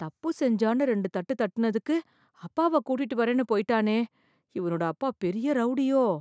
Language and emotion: Tamil, fearful